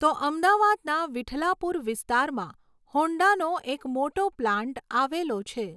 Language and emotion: Gujarati, neutral